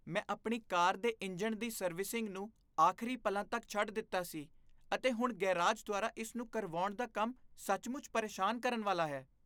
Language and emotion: Punjabi, disgusted